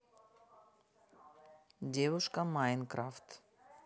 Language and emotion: Russian, neutral